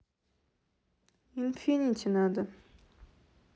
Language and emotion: Russian, neutral